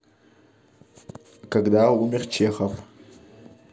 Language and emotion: Russian, neutral